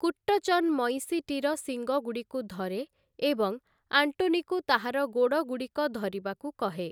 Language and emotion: Odia, neutral